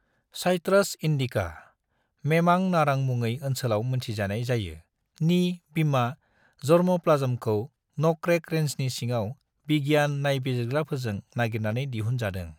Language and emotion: Bodo, neutral